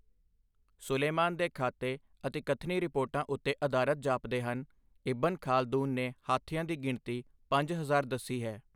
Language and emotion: Punjabi, neutral